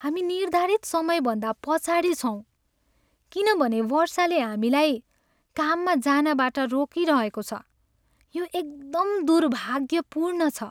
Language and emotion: Nepali, sad